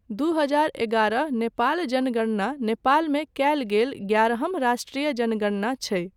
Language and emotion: Maithili, neutral